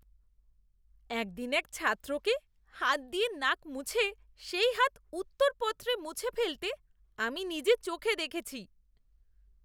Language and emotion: Bengali, disgusted